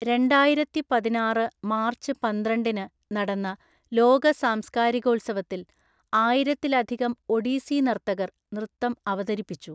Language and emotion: Malayalam, neutral